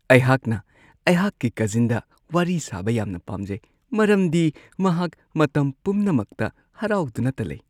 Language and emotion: Manipuri, happy